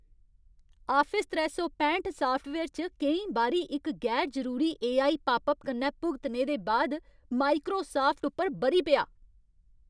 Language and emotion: Dogri, angry